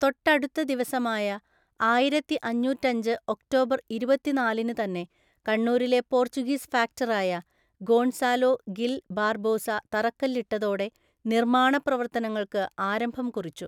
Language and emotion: Malayalam, neutral